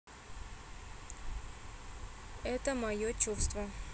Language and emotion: Russian, neutral